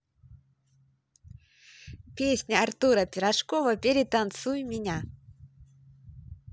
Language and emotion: Russian, positive